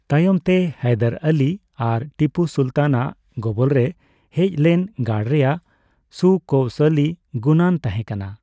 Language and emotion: Santali, neutral